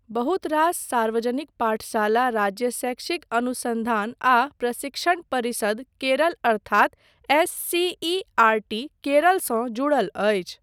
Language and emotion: Maithili, neutral